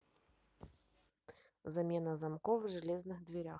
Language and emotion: Russian, neutral